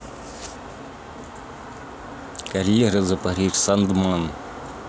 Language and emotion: Russian, neutral